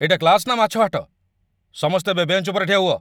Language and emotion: Odia, angry